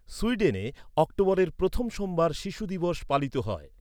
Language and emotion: Bengali, neutral